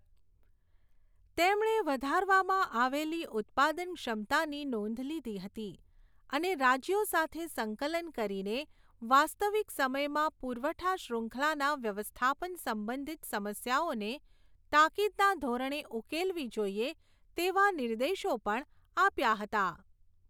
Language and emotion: Gujarati, neutral